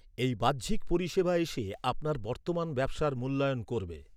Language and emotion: Bengali, neutral